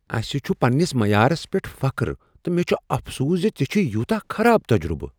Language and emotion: Kashmiri, surprised